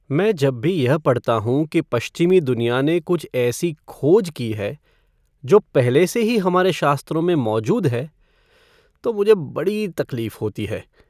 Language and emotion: Hindi, sad